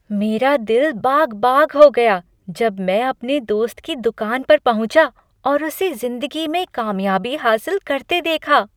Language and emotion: Hindi, happy